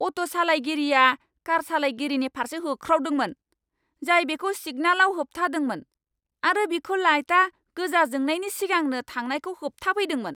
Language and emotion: Bodo, angry